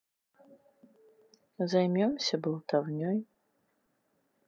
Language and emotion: Russian, neutral